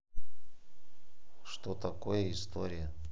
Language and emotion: Russian, neutral